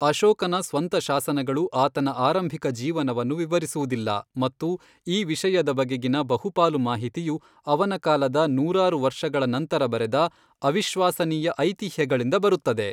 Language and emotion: Kannada, neutral